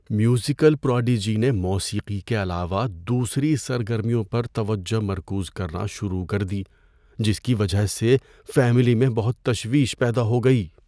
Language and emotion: Urdu, fearful